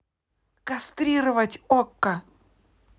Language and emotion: Russian, angry